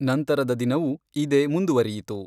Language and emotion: Kannada, neutral